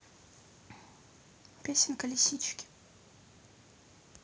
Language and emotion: Russian, neutral